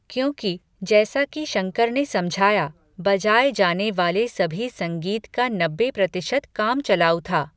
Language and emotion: Hindi, neutral